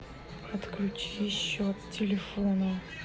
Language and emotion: Russian, angry